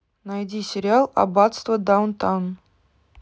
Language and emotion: Russian, neutral